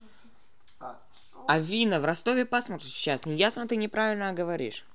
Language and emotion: Russian, positive